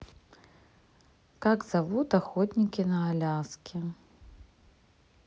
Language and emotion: Russian, neutral